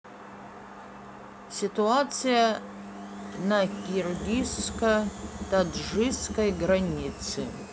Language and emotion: Russian, neutral